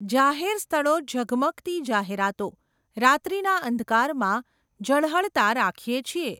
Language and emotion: Gujarati, neutral